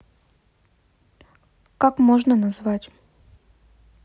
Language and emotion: Russian, neutral